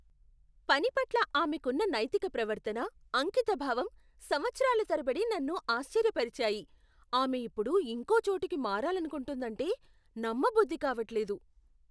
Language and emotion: Telugu, surprised